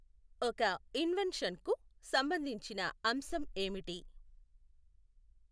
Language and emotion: Telugu, neutral